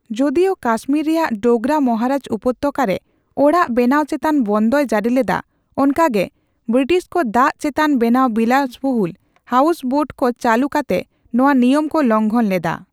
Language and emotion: Santali, neutral